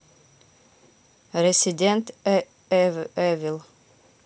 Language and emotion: Russian, neutral